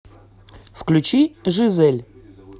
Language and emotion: Russian, neutral